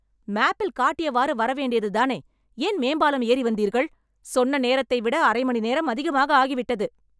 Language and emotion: Tamil, angry